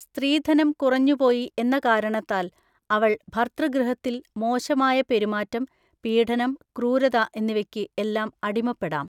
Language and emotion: Malayalam, neutral